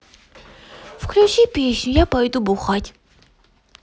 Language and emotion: Russian, positive